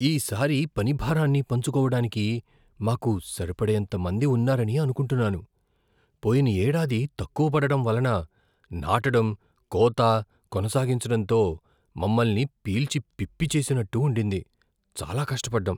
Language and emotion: Telugu, fearful